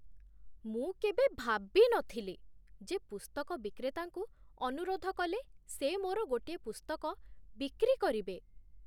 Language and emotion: Odia, surprised